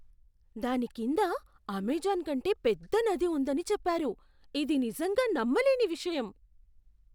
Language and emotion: Telugu, surprised